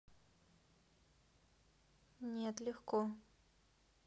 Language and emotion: Russian, neutral